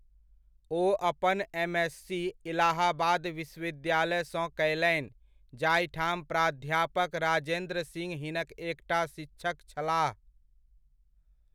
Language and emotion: Maithili, neutral